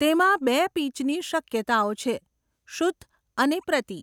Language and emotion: Gujarati, neutral